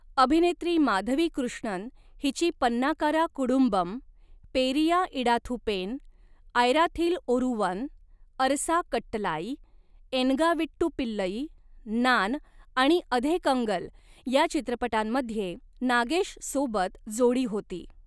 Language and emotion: Marathi, neutral